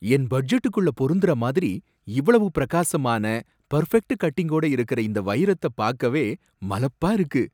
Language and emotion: Tamil, surprised